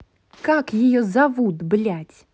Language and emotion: Russian, angry